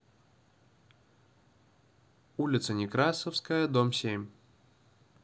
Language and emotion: Russian, neutral